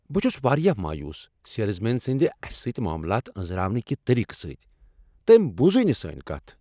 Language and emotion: Kashmiri, angry